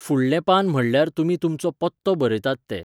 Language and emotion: Goan Konkani, neutral